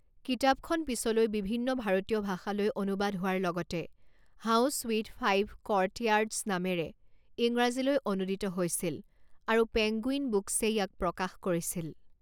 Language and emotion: Assamese, neutral